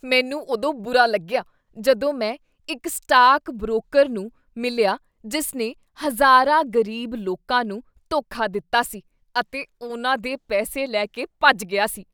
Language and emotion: Punjabi, disgusted